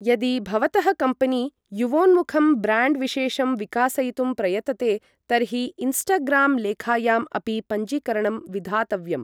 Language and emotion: Sanskrit, neutral